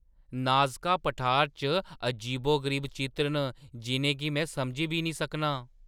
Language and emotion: Dogri, surprised